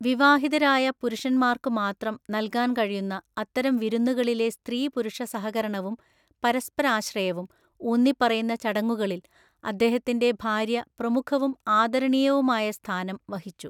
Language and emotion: Malayalam, neutral